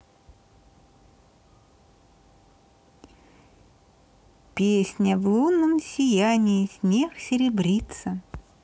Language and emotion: Russian, neutral